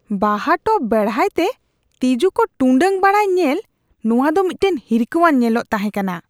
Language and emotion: Santali, disgusted